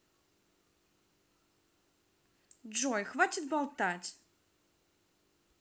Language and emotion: Russian, angry